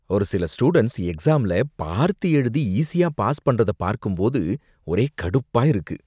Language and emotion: Tamil, disgusted